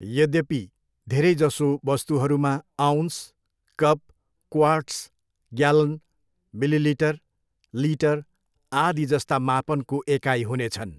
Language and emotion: Nepali, neutral